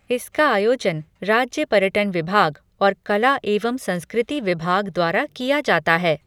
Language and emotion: Hindi, neutral